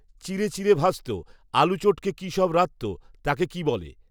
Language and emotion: Bengali, neutral